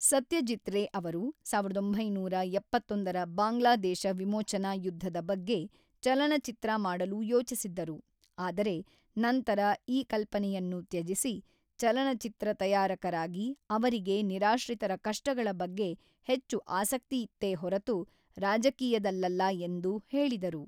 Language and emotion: Kannada, neutral